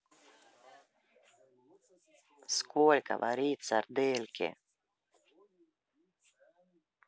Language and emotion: Russian, angry